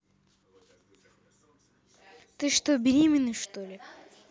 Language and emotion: Russian, neutral